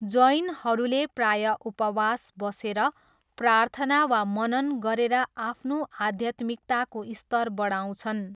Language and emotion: Nepali, neutral